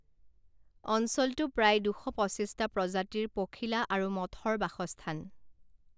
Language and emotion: Assamese, neutral